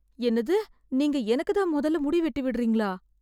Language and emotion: Tamil, fearful